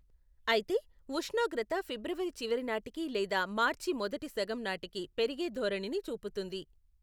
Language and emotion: Telugu, neutral